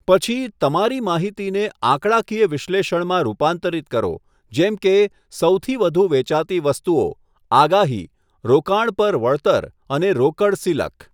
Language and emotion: Gujarati, neutral